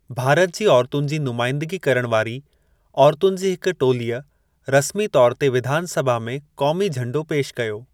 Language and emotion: Sindhi, neutral